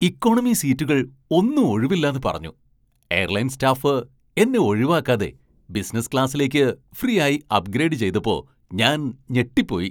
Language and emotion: Malayalam, surprised